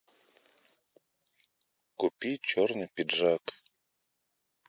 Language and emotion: Russian, neutral